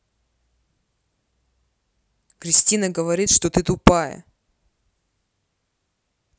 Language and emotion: Russian, angry